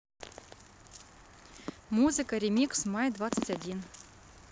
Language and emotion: Russian, neutral